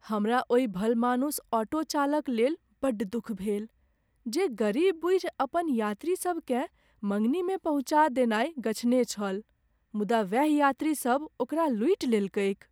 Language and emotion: Maithili, sad